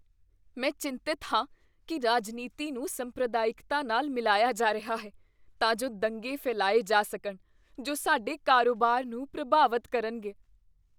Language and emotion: Punjabi, fearful